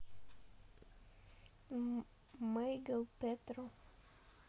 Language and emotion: Russian, neutral